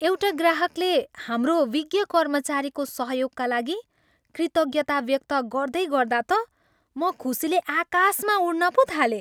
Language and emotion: Nepali, happy